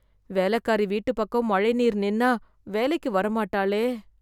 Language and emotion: Tamil, fearful